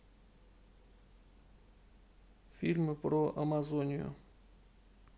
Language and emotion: Russian, neutral